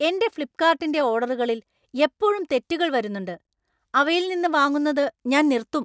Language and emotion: Malayalam, angry